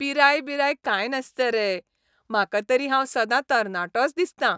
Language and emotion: Goan Konkani, happy